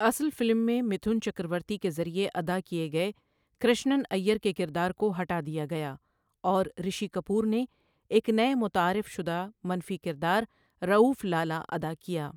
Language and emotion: Urdu, neutral